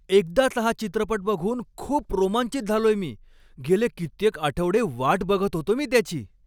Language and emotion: Marathi, happy